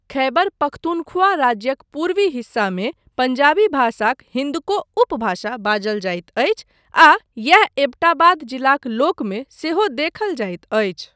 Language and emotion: Maithili, neutral